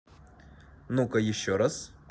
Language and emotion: Russian, positive